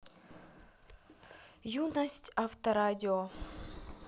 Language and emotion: Russian, neutral